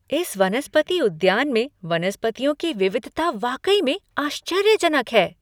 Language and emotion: Hindi, surprised